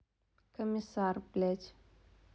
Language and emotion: Russian, neutral